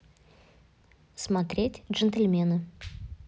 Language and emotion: Russian, neutral